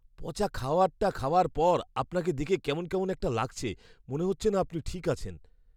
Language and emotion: Bengali, fearful